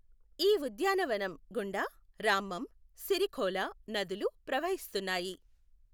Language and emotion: Telugu, neutral